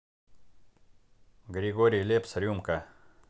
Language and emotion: Russian, neutral